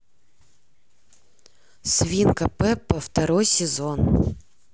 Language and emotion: Russian, neutral